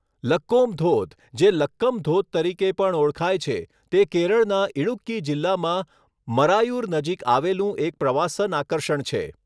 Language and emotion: Gujarati, neutral